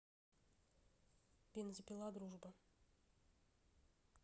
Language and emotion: Russian, neutral